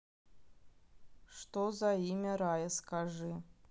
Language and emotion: Russian, neutral